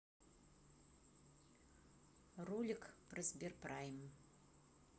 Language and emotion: Russian, neutral